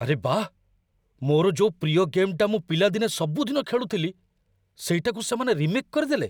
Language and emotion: Odia, surprised